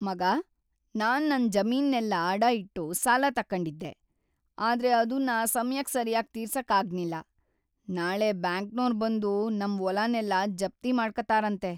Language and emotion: Kannada, sad